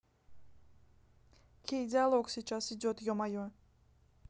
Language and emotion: Russian, angry